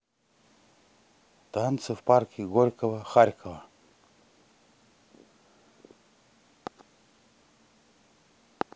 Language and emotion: Russian, neutral